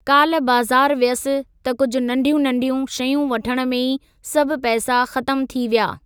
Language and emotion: Sindhi, neutral